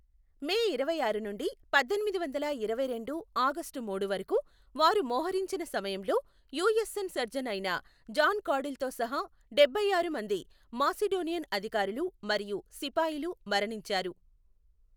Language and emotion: Telugu, neutral